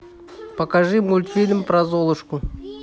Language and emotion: Russian, neutral